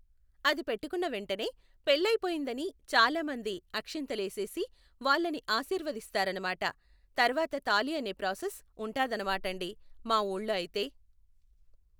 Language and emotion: Telugu, neutral